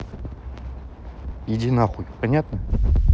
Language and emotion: Russian, angry